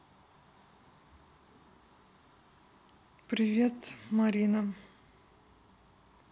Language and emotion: Russian, neutral